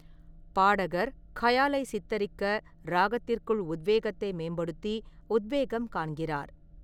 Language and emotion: Tamil, neutral